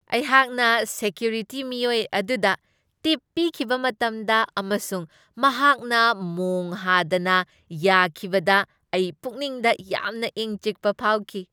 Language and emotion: Manipuri, happy